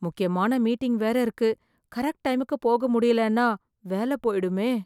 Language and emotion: Tamil, fearful